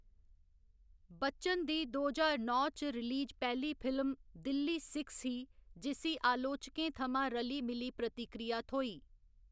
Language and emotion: Dogri, neutral